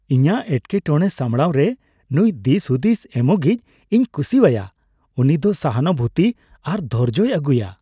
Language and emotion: Santali, happy